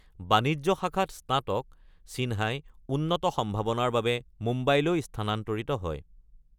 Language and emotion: Assamese, neutral